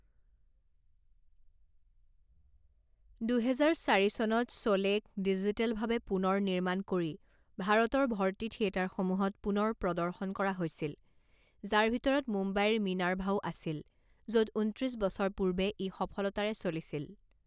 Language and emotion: Assamese, neutral